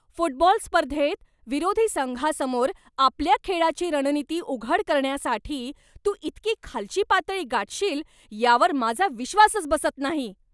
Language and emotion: Marathi, angry